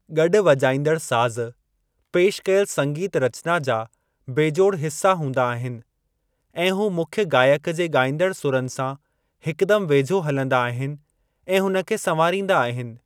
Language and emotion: Sindhi, neutral